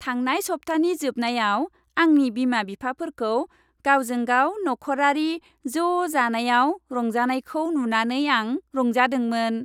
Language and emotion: Bodo, happy